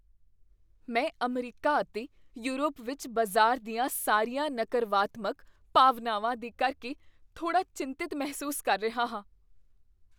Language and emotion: Punjabi, fearful